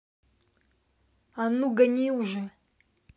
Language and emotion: Russian, angry